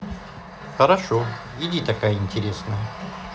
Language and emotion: Russian, neutral